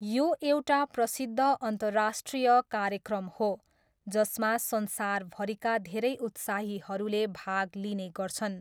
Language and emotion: Nepali, neutral